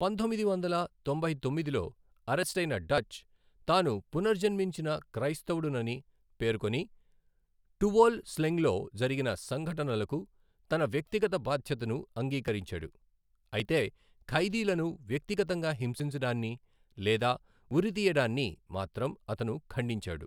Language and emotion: Telugu, neutral